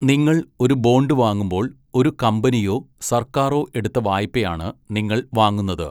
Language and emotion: Malayalam, neutral